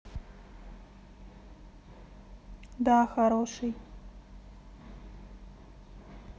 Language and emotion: Russian, neutral